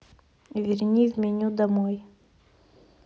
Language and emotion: Russian, neutral